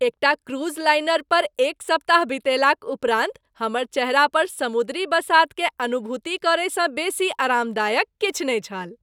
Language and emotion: Maithili, happy